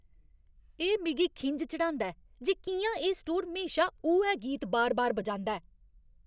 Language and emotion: Dogri, angry